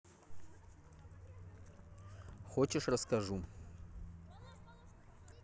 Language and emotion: Russian, neutral